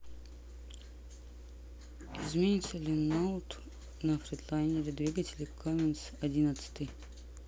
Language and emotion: Russian, neutral